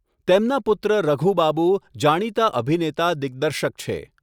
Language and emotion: Gujarati, neutral